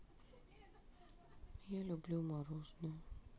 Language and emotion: Russian, sad